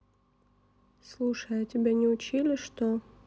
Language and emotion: Russian, neutral